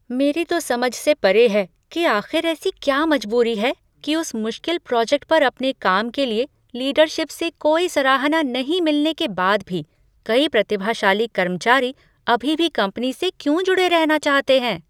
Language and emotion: Hindi, surprised